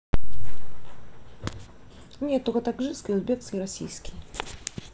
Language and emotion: Russian, neutral